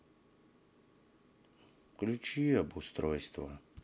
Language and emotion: Russian, sad